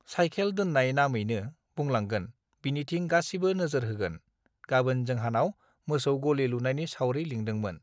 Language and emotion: Bodo, neutral